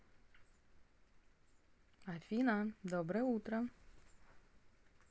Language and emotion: Russian, positive